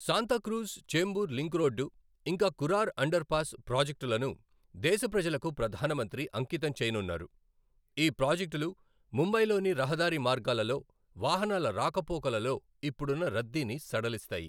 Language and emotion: Telugu, neutral